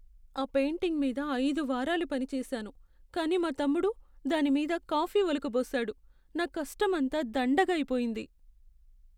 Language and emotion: Telugu, sad